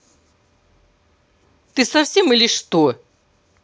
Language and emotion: Russian, angry